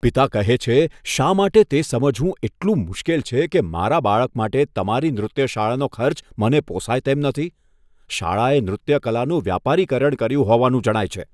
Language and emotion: Gujarati, disgusted